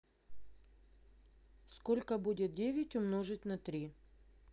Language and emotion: Russian, neutral